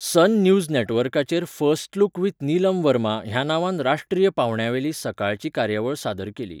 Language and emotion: Goan Konkani, neutral